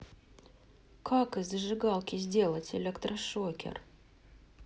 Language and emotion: Russian, neutral